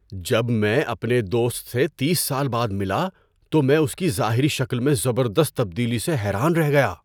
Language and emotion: Urdu, surprised